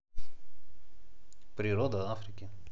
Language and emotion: Russian, neutral